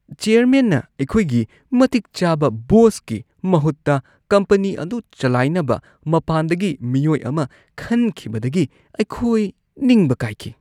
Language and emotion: Manipuri, disgusted